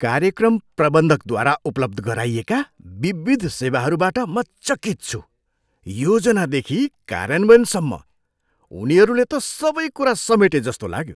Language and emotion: Nepali, surprised